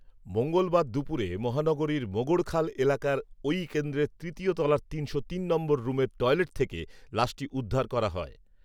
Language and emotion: Bengali, neutral